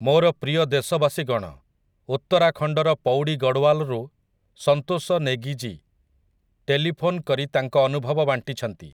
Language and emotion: Odia, neutral